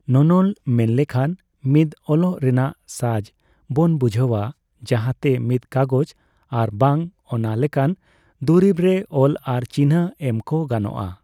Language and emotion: Santali, neutral